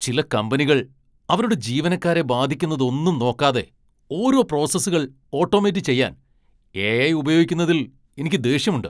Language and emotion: Malayalam, angry